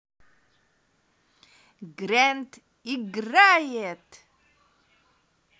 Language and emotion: Russian, positive